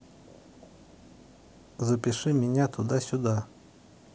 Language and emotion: Russian, neutral